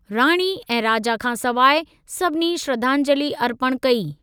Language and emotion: Sindhi, neutral